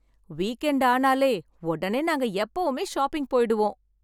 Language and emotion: Tamil, happy